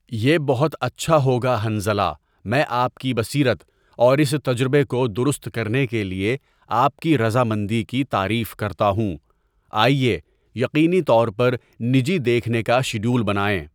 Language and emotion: Urdu, neutral